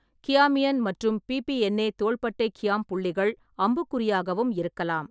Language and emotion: Tamil, neutral